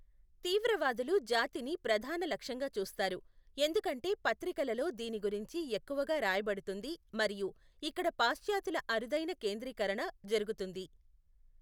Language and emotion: Telugu, neutral